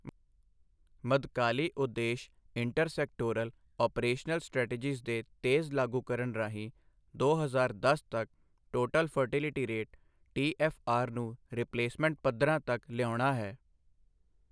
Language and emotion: Punjabi, neutral